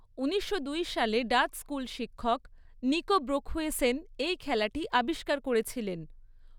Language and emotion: Bengali, neutral